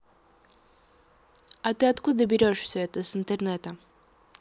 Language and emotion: Russian, neutral